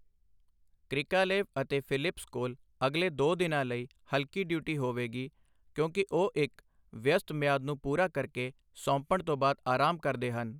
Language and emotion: Punjabi, neutral